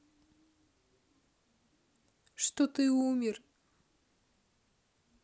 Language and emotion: Russian, neutral